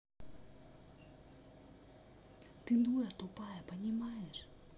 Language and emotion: Russian, neutral